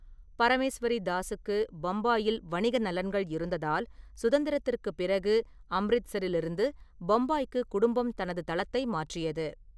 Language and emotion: Tamil, neutral